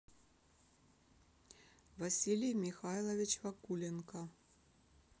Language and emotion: Russian, neutral